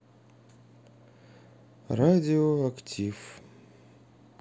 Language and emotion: Russian, sad